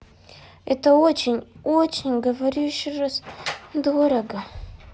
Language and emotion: Russian, sad